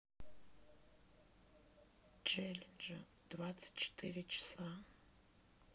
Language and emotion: Russian, sad